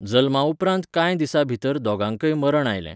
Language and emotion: Goan Konkani, neutral